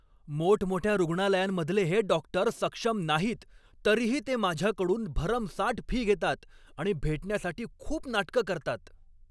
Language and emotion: Marathi, angry